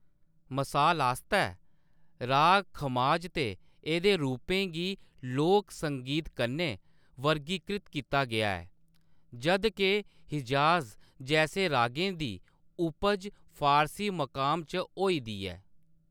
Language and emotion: Dogri, neutral